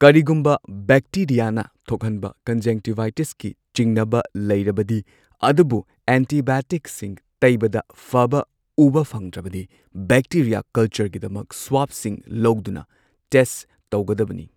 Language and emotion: Manipuri, neutral